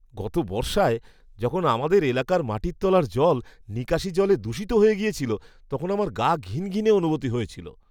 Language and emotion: Bengali, disgusted